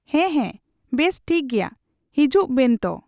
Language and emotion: Santali, neutral